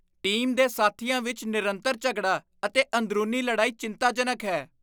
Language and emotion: Punjabi, disgusted